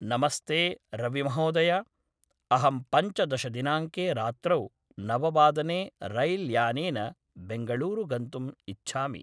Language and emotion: Sanskrit, neutral